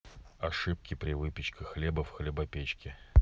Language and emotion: Russian, neutral